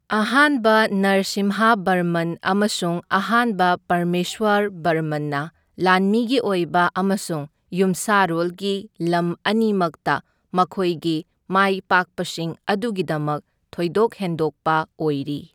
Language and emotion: Manipuri, neutral